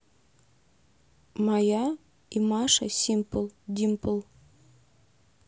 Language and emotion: Russian, neutral